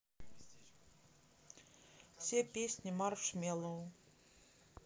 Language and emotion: Russian, neutral